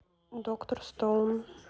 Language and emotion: Russian, neutral